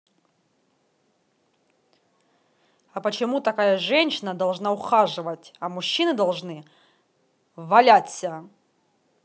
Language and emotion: Russian, angry